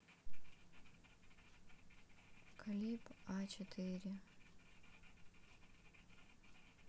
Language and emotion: Russian, sad